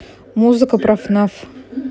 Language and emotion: Russian, neutral